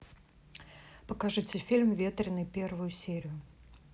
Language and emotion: Russian, neutral